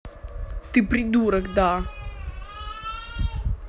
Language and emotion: Russian, angry